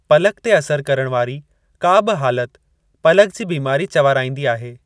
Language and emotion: Sindhi, neutral